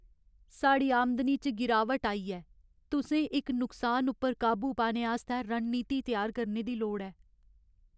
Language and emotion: Dogri, sad